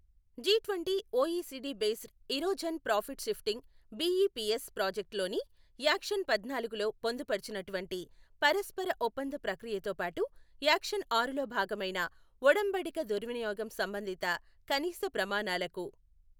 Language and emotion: Telugu, neutral